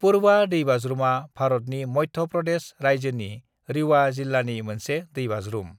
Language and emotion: Bodo, neutral